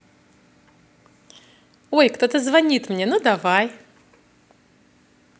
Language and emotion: Russian, positive